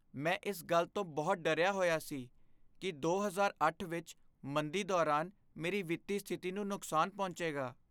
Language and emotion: Punjabi, fearful